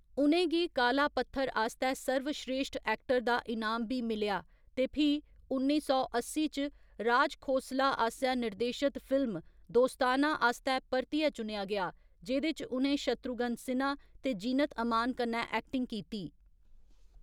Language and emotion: Dogri, neutral